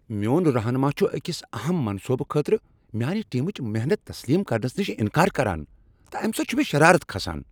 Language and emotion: Kashmiri, angry